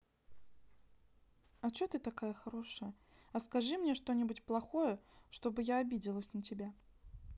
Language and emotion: Russian, sad